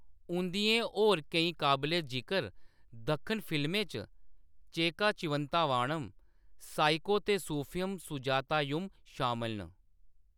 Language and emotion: Dogri, neutral